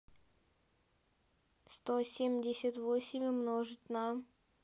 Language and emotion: Russian, neutral